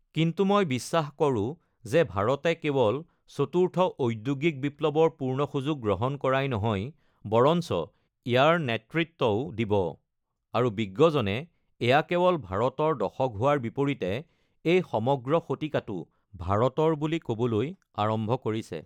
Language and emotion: Assamese, neutral